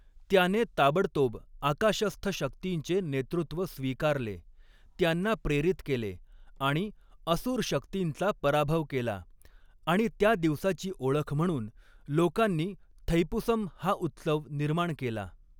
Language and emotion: Marathi, neutral